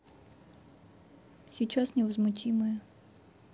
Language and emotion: Russian, neutral